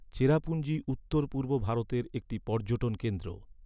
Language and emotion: Bengali, neutral